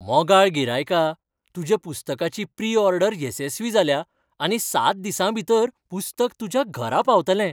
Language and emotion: Goan Konkani, happy